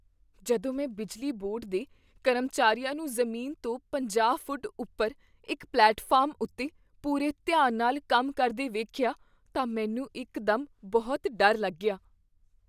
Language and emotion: Punjabi, fearful